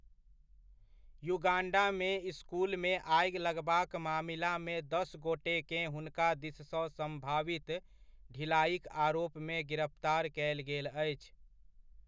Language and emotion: Maithili, neutral